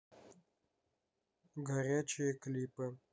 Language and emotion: Russian, neutral